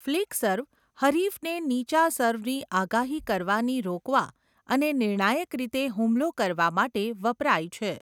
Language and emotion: Gujarati, neutral